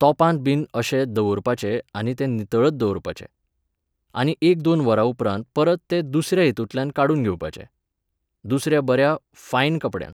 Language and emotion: Goan Konkani, neutral